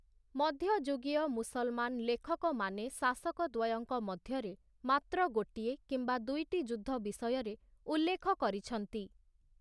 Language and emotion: Odia, neutral